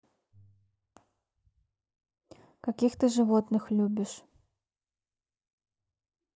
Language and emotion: Russian, neutral